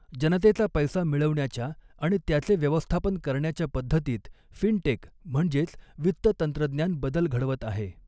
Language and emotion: Marathi, neutral